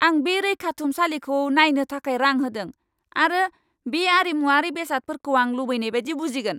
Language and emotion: Bodo, angry